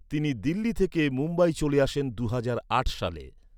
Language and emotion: Bengali, neutral